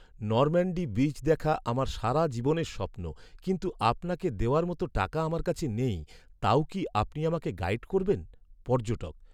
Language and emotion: Bengali, sad